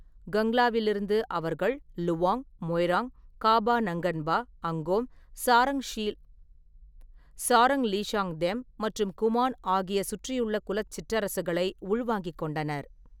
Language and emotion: Tamil, neutral